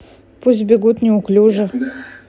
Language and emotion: Russian, neutral